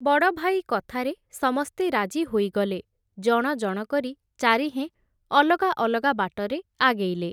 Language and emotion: Odia, neutral